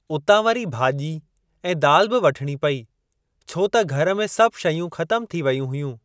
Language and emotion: Sindhi, neutral